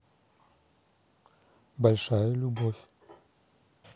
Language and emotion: Russian, neutral